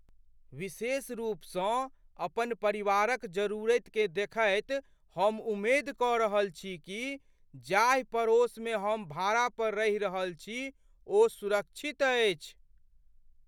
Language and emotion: Maithili, fearful